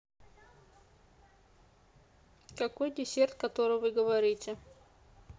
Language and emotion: Russian, neutral